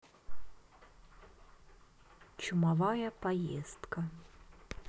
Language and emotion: Russian, neutral